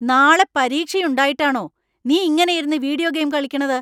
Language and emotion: Malayalam, angry